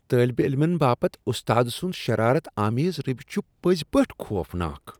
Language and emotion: Kashmiri, disgusted